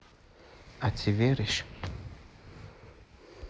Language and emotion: Russian, neutral